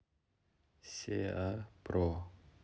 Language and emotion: Russian, neutral